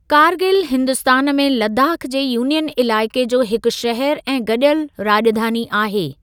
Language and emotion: Sindhi, neutral